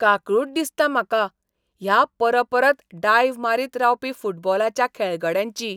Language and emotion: Goan Konkani, disgusted